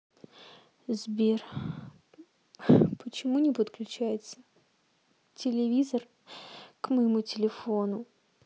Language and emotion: Russian, sad